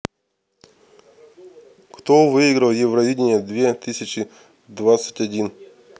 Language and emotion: Russian, neutral